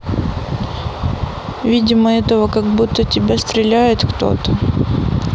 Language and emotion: Russian, sad